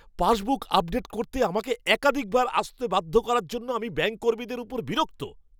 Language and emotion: Bengali, angry